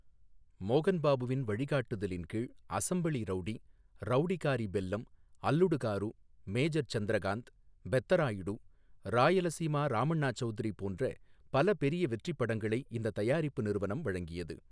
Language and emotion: Tamil, neutral